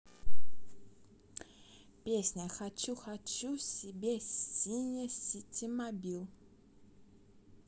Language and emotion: Russian, positive